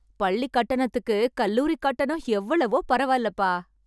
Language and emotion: Tamil, happy